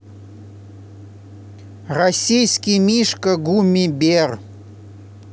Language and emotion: Russian, neutral